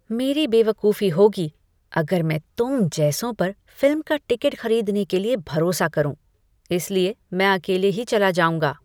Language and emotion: Hindi, disgusted